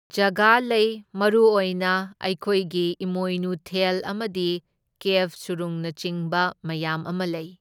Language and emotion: Manipuri, neutral